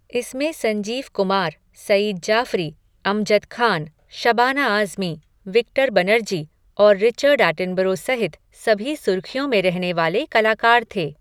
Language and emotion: Hindi, neutral